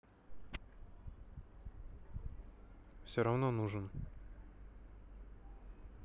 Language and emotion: Russian, neutral